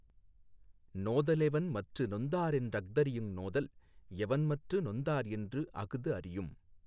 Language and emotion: Tamil, neutral